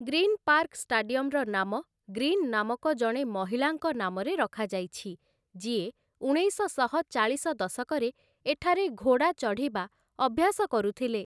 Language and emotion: Odia, neutral